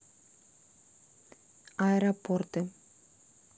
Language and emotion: Russian, neutral